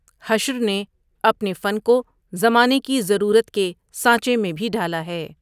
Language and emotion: Urdu, neutral